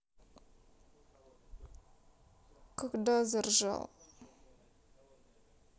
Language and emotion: Russian, sad